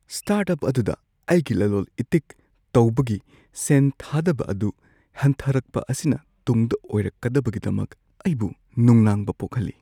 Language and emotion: Manipuri, fearful